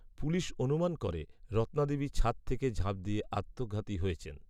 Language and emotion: Bengali, neutral